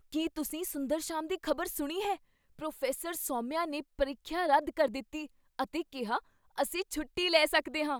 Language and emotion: Punjabi, surprised